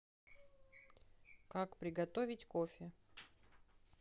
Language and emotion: Russian, neutral